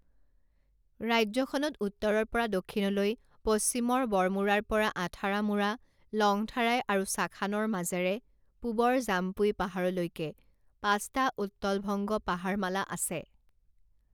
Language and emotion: Assamese, neutral